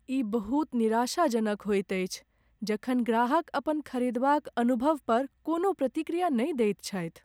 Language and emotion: Maithili, sad